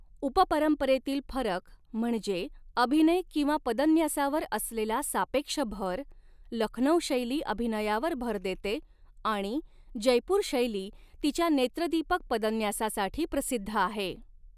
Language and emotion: Marathi, neutral